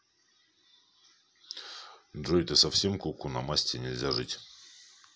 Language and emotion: Russian, neutral